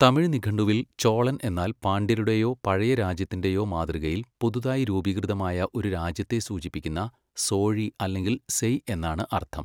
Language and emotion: Malayalam, neutral